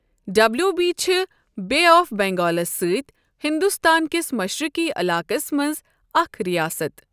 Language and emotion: Kashmiri, neutral